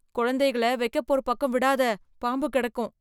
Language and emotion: Tamil, fearful